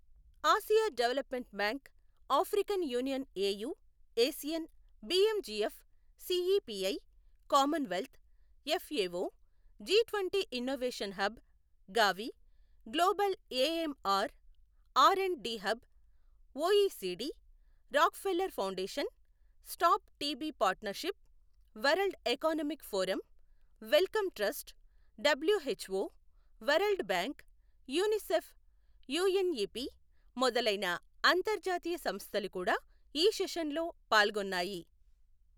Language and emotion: Telugu, neutral